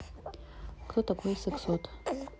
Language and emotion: Russian, neutral